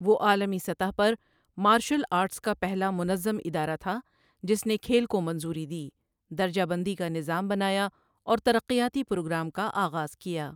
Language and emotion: Urdu, neutral